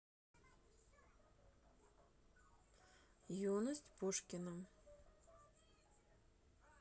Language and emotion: Russian, neutral